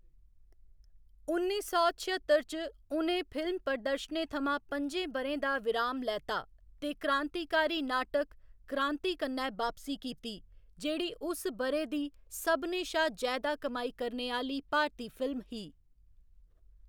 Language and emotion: Dogri, neutral